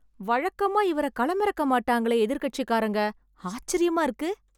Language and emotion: Tamil, surprised